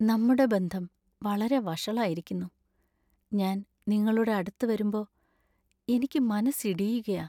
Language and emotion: Malayalam, sad